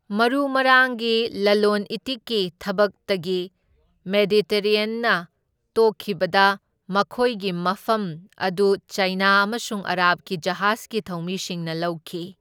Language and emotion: Manipuri, neutral